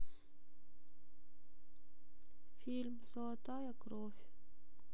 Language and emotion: Russian, sad